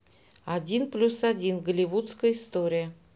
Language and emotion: Russian, neutral